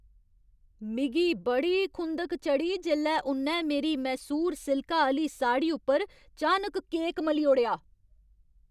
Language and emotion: Dogri, angry